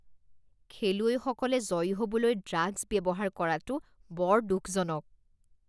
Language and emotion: Assamese, disgusted